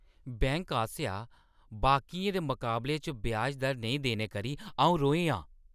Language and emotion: Dogri, angry